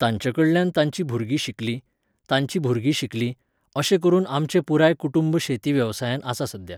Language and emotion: Goan Konkani, neutral